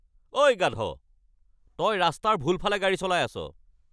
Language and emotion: Assamese, angry